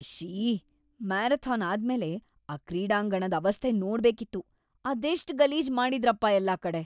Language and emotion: Kannada, disgusted